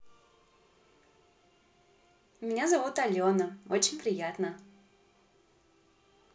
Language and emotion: Russian, positive